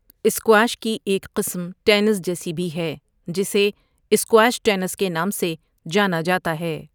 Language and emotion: Urdu, neutral